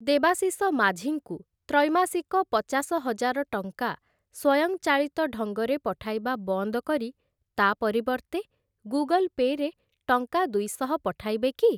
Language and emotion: Odia, neutral